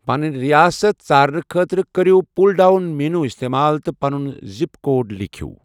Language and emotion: Kashmiri, neutral